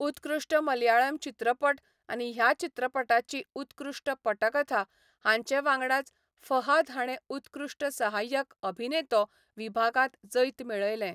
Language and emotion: Goan Konkani, neutral